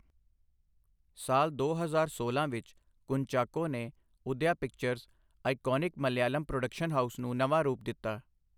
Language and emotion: Punjabi, neutral